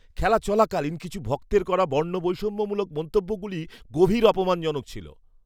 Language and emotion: Bengali, disgusted